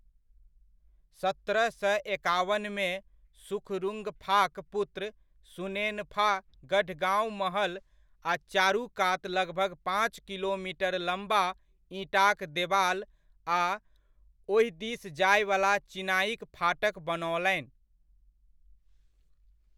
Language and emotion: Maithili, neutral